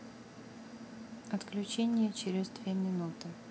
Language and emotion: Russian, neutral